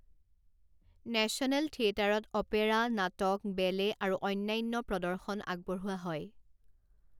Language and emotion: Assamese, neutral